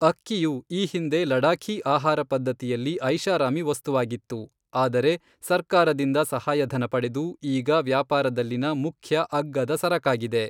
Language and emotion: Kannada, neutral